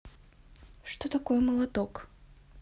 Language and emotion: Russian, neutral